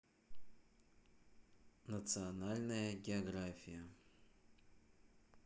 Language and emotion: Russian, neutral